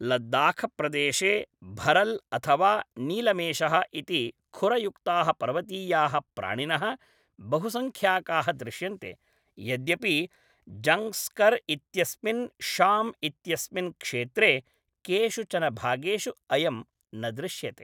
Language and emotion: Sanskrit, neutral